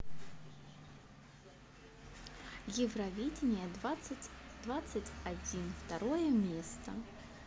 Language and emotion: Russian, neutral